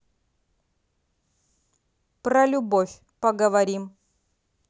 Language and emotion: Russian, angry